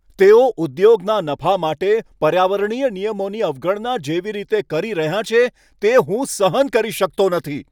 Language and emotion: Gujarati, angry